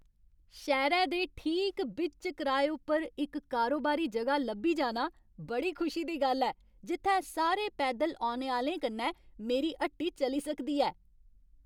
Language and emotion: Dogri, happy